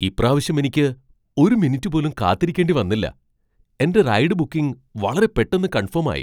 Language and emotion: Malayalam, surprised